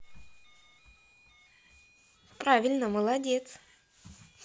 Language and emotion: Russian, positive